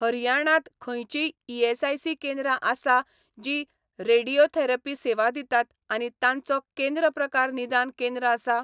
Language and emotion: Goan Konkani, neutral